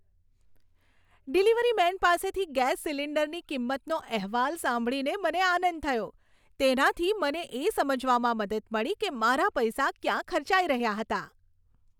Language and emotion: Gujarati, happy